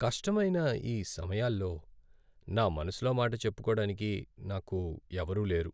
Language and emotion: Telugu, sad